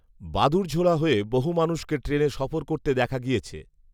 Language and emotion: Bengali, neutral